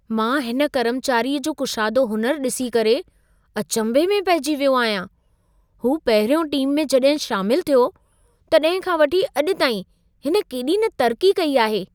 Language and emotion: Sindhi, surprised